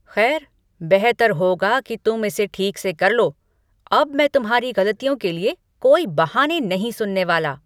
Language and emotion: Hindi, angry